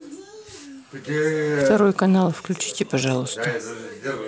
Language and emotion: Russian, neutral